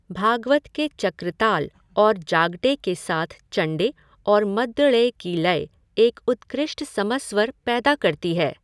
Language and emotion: Hindi, neutral